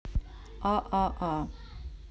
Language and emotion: Russian, neutral